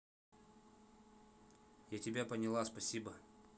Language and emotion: Russian, neutral